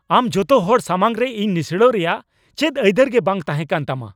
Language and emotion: Santali, angry